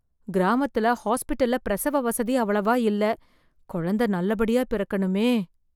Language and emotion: Tamil, fearful